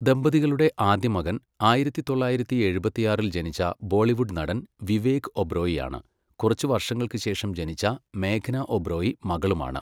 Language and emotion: Malayalam, neutral